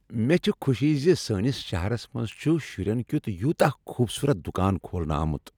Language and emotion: Kashmiri, happy